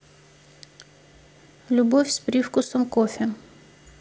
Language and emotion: Russian, neutral